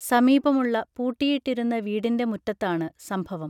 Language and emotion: Malayalam, neutral